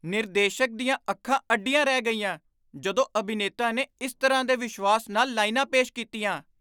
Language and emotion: Punjabi, surprised